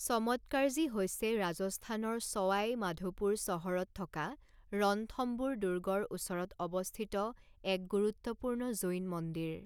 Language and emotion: Assamese, neutral